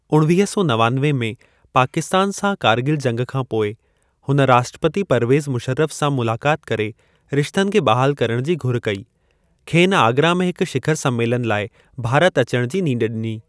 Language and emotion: Sindhi, neutral